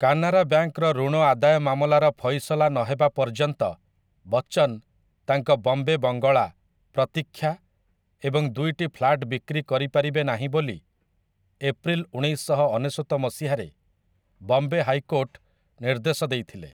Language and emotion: Odia, neutral